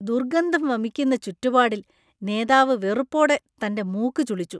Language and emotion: Malayalam, disgusted